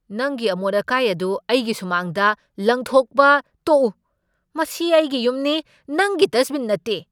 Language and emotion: Manipuri, angry